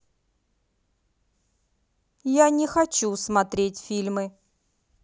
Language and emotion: Russian, angry